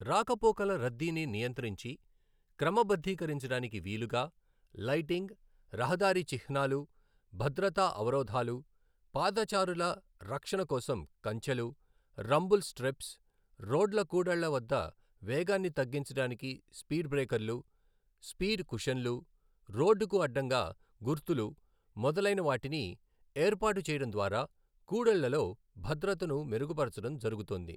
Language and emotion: Telugu, neutral